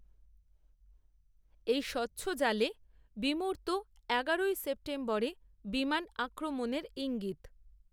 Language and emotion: Bengali, neutral